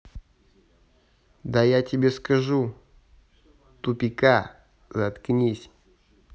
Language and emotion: Russian, angry